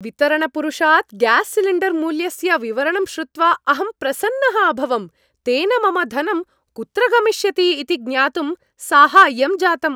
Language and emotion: Sanskrit, happy